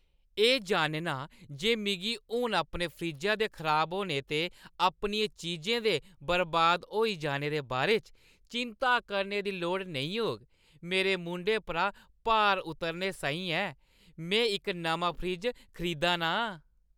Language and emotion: Dogri, happy